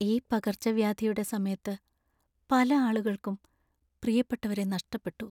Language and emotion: Malayalam, sad